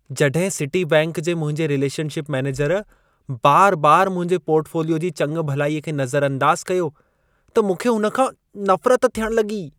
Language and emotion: Sindhi, disgusted